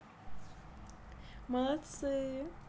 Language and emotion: Russian, positive